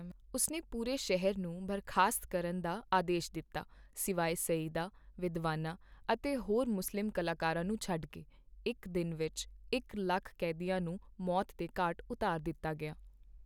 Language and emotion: Punjabi, neutral